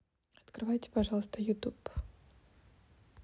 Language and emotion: Russian, neutral